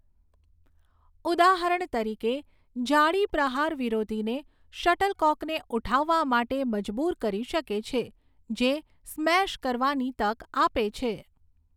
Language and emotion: Gujarati, neutral